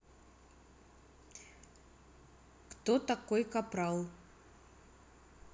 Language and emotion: Russian, neutral